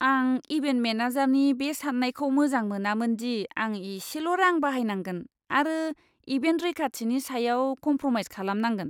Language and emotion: Bodo, disgusted